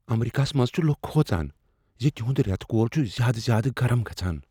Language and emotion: Kashmiri, fearful